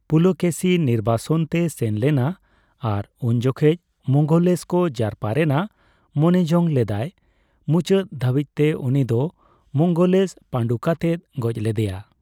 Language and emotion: Santali, neutral